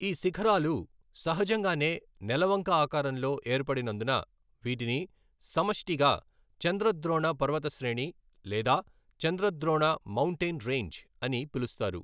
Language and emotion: Telugu, neutral